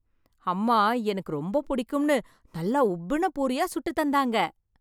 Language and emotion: Tamil, happy